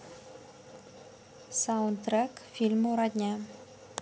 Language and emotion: Russian, neutral